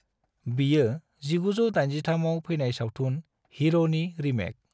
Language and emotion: Bodo, neutral